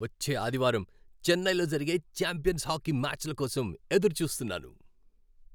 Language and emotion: Telugu, happy